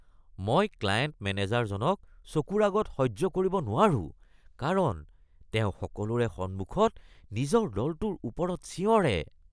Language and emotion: Assamese, disgusted